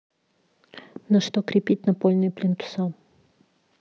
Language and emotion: Russian, neutral